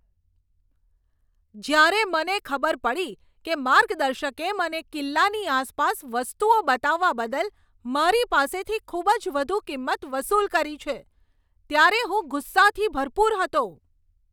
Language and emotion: Gujarati, angry